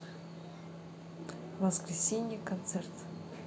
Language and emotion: Russian, neutral